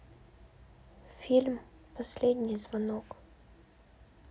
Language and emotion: Russian, sad